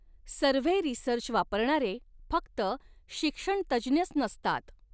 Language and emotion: Marathi, neutral